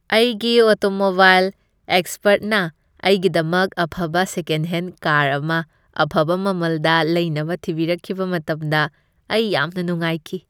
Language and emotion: Manipuri, happy